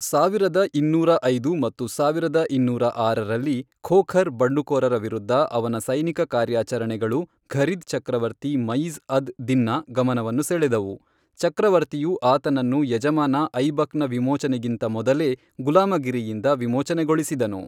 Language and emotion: Kannada, neutral